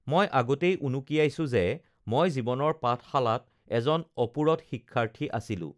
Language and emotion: Assamese, neutral